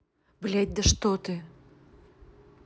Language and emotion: Russian, angry